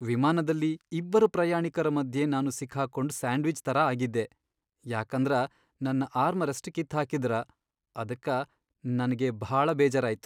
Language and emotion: Kannada, sad